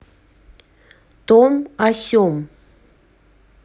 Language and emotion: Russian, neutral